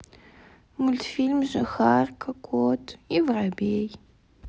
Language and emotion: Russian, sad